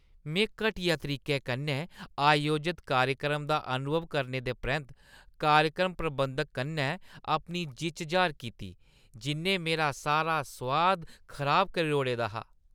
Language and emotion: Dogri, disgusted